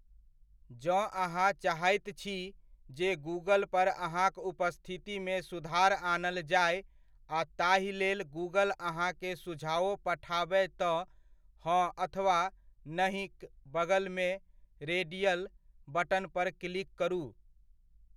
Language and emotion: Maithili, neutral